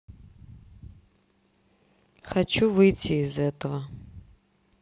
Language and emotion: Russian, sad